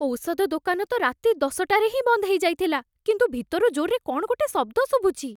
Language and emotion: Odia, fearful